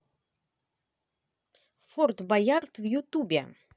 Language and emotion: Russian, positive